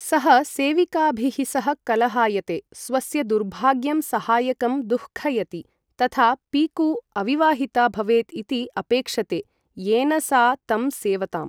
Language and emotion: Sanskrit, neutral